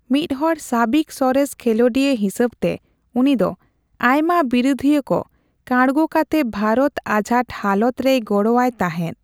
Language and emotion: Santali, neutral